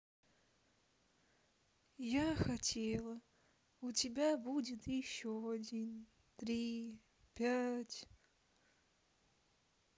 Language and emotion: Russian, sad